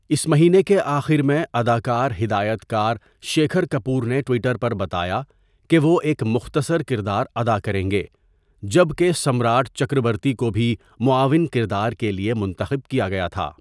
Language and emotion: Urdu, neutral